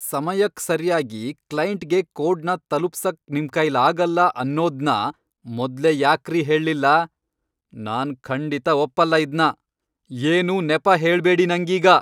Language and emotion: Kannada, angry